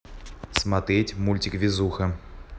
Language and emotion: Russian, neutral